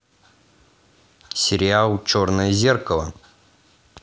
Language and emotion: Russian, positive